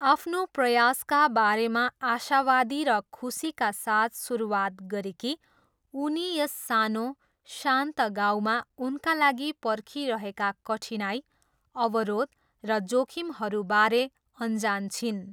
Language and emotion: Nepali, neutral